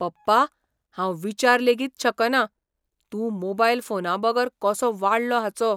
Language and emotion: Goan Konkani, surprised